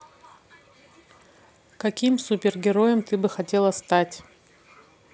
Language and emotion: Russian, neutral